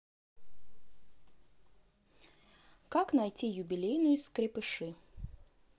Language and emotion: Russian, neutral